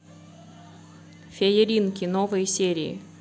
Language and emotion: Russian, neutral